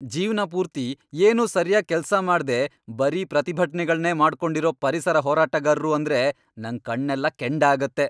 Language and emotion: Kannada, angry